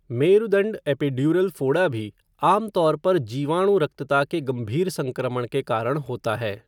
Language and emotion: Hindi, neutral